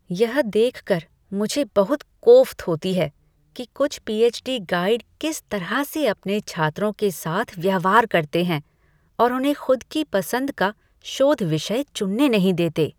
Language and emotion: Hindi, disgusted